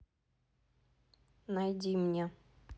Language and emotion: Russian, neutral